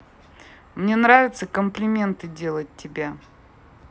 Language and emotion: Russian, neutral